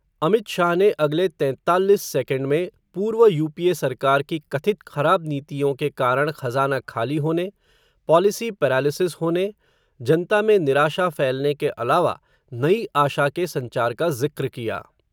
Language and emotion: Hindi, neutral